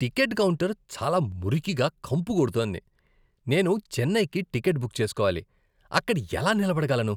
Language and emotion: Telugu, disgusted